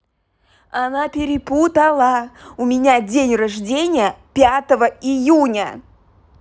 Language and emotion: Russian, angry